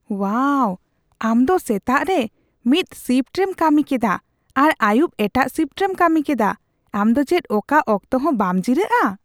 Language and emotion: Santali, surprised